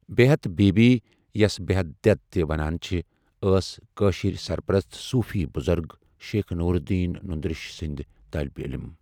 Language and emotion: Kashmiri, neutral